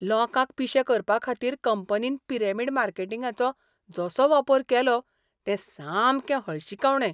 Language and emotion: Goan Konkani, disgusted